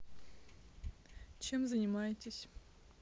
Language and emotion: Russian, neutral